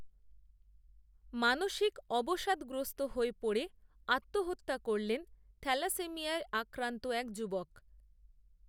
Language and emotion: Bengali, neutral